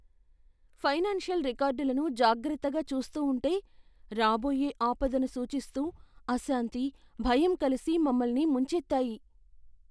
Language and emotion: Telugu, fearful